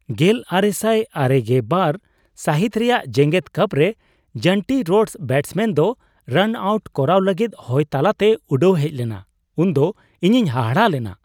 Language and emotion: Santali, surprised